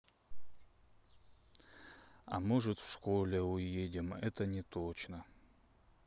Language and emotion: Russian, sad